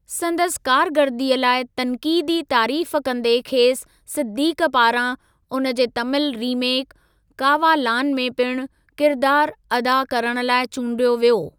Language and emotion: Sindhi, neutral